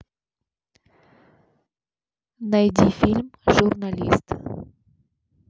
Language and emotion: Russian, neutral